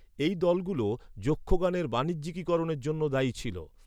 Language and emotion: Bengali, neutral